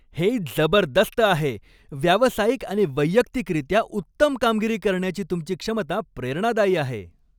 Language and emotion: Marathi, happy